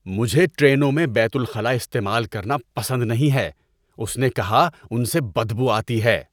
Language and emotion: Urdu, disgusted